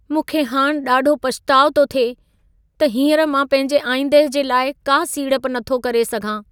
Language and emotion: Sindhi, sad